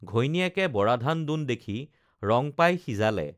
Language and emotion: Assamese, neutral